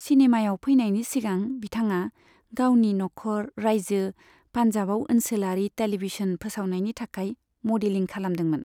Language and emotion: Bodo, neutral